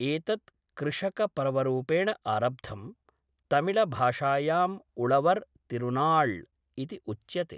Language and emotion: Sanskrit, neutral